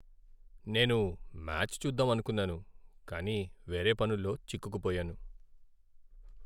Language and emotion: Telugu, sad